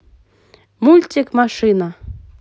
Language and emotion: Russian, positive